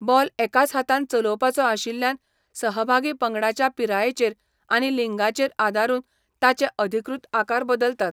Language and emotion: Goan Konkani, neutral